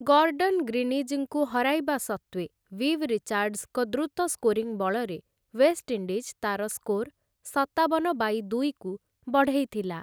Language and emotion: Odia, neutral